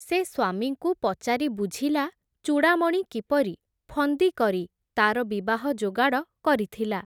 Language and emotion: Odia, neutral